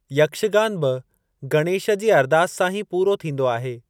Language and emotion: Sindhi, neutral